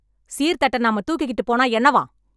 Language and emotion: Tamil, angry